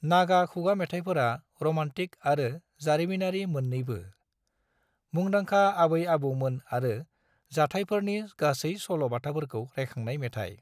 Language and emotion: Bodo, neutral